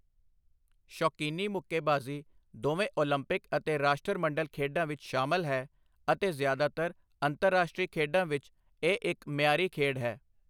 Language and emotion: Punjabi, neutral